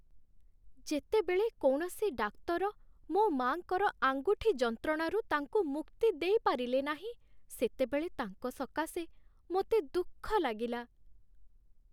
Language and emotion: Odia, sad